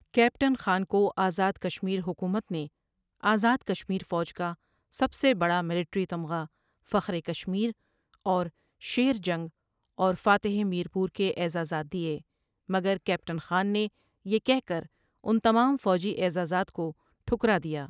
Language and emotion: Urdu, neutral